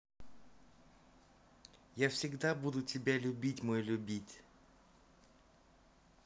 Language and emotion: Russian, positive